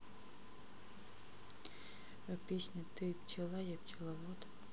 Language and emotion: Russian, neutral